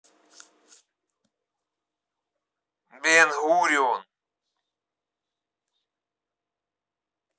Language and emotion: Russian, neutral